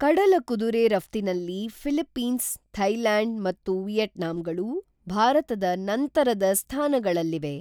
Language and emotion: Kannada, neutral